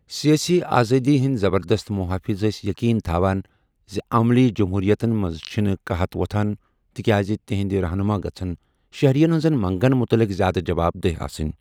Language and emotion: Kashmiri, neutral